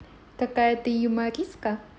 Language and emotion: Russian, positive